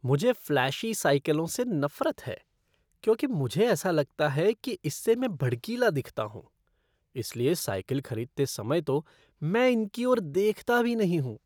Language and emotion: Hindi, disgusted